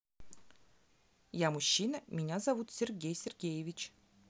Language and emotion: Russian, neutral